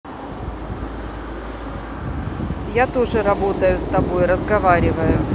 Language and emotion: Russian, neutral